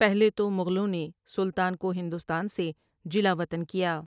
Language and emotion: Urdu, neutral